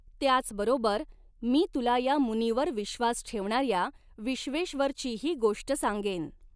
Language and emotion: Marathi, neutral